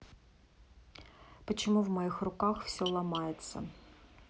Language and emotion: Russian, neutral